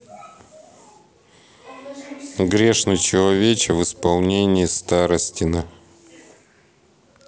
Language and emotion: Russian, neutral